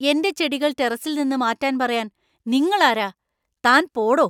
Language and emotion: Malayalam, angry